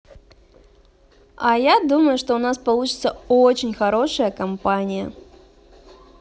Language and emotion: Russian, positive